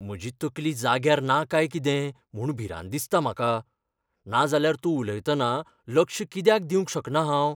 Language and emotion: Goan Konkani, fearful